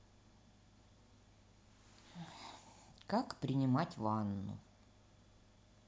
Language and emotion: Russian, neutral